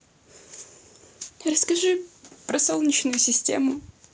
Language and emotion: Russian, neutral